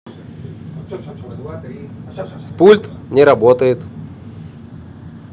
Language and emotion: Russian, neutral